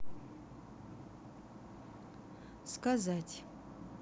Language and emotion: Russian, neutral